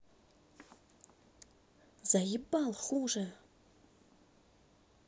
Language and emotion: Russian, angry